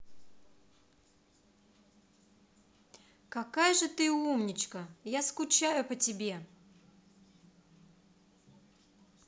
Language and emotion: Russian, positive